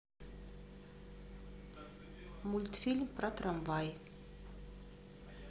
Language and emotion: Russian, neutral